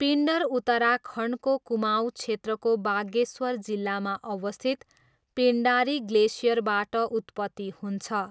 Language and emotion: Nepali, neutral